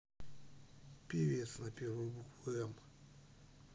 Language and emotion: Russian, neutral